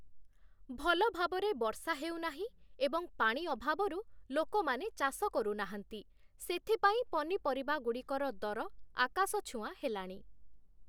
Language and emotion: Odia, neutral